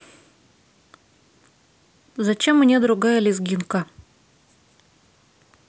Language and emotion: Russian, neutral